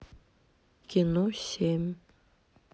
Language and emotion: Russian, neutral